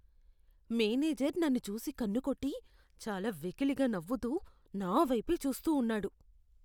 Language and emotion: Telugu, disgusted